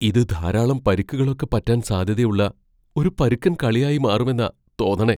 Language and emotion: Malayalam, fearful